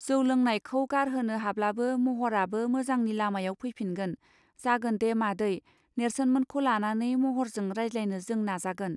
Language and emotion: Bodo, neutral